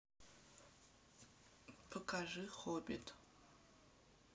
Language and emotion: Russian, neutral